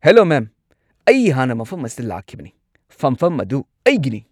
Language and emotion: Manipuri, angry